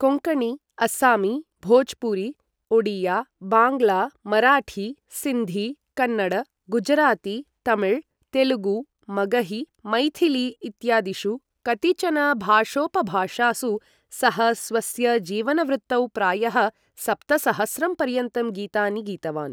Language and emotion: Sanskrit, neutral